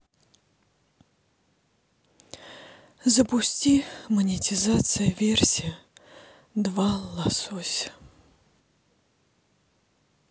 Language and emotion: Russian, sad